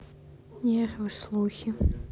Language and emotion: Russian, sad